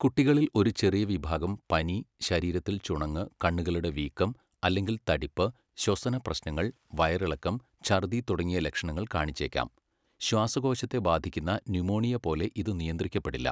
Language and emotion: Malayalam, neutral